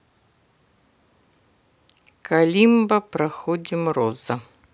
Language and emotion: Russian, neutral